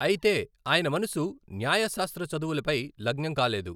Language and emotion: Telugu, neutral